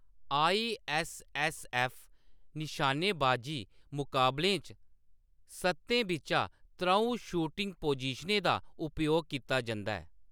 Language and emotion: Dogri, neutral